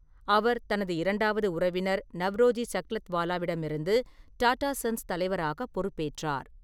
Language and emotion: Tamil, neutral